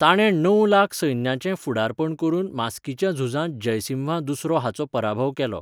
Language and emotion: Goan Konkani, neutral